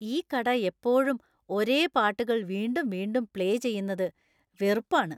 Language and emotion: Malayalam, disgusted